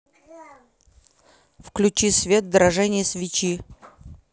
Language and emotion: Russian, neutral